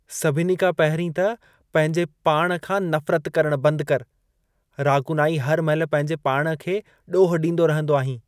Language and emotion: Sindhi, disgusted